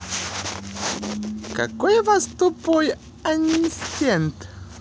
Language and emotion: Russian, positive